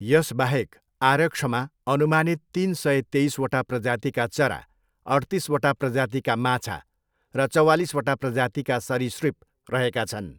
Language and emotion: Nepali, neutral